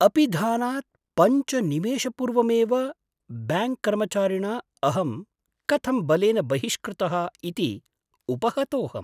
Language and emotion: Sanskrit, surprised